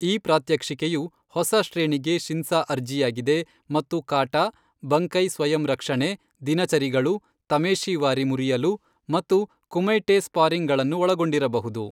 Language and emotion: Kannada, neutral